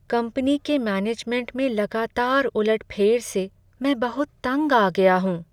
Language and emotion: Hindi, sad